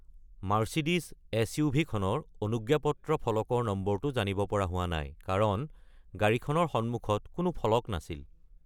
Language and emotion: Assamese, neutral